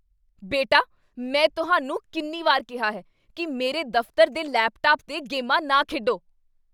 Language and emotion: Punjabi, angry